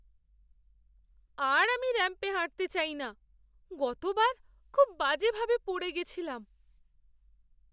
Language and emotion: Bengali, fearful